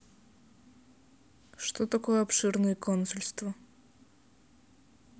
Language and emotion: Russian, neutral